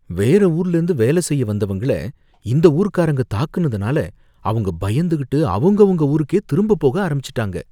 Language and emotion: Tamil, fearful